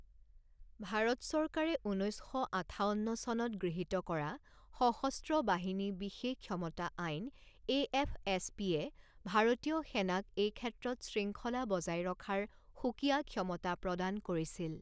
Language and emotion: Assamese, neutral